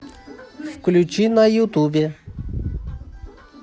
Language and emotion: Russian, positive